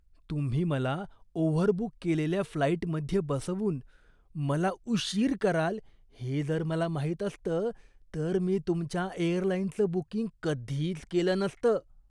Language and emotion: Marathi, disgusted